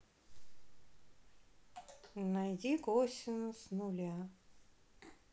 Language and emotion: Russian, sad